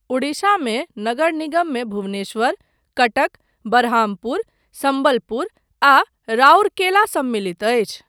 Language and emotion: Maithili, neutral